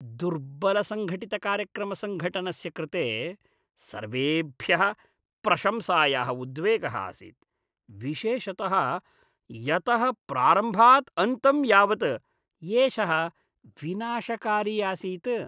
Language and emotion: Sanskrit, disgusted